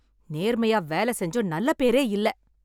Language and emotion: Tamil, angry